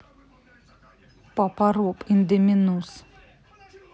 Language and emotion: Russian, angry